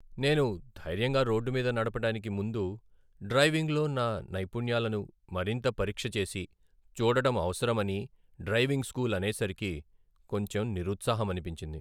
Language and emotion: Telugu, sad